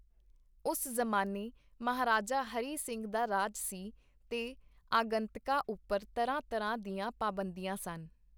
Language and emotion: Punjabi, neutral